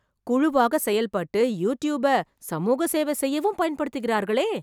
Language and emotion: Tamil, surprised